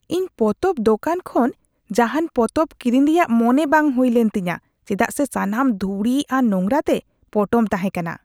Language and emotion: Santali, disgusted